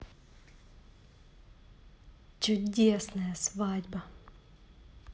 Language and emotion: Russian, positive